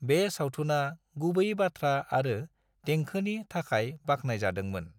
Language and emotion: Bodo, neutral